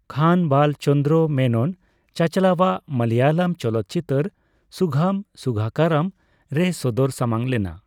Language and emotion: Santali, neutral